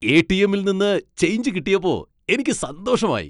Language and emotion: Malayalam, happy